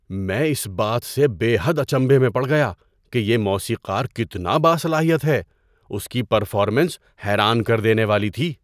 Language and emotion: Urdu, surprised